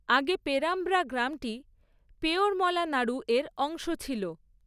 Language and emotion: Bengali, neutral